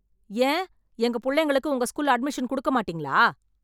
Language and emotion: Tamil, angry